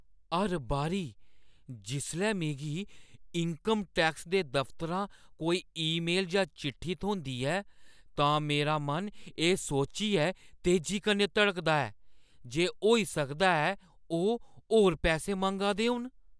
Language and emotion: Dogri, fearful